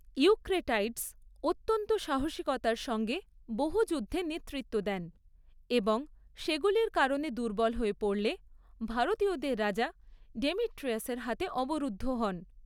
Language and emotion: Bengali, neutral